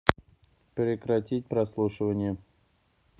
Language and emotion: Russian, neutral